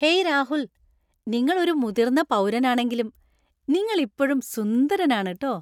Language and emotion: Malayalam, happy